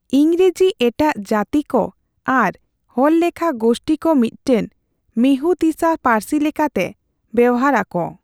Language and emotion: Santali, neutral